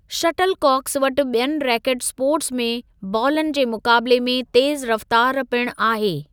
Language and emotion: Sindhi, neutral